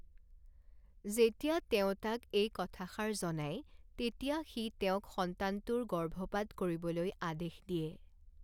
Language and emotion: Assamese, neutral